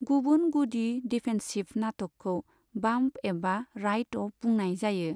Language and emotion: Bodo, neutral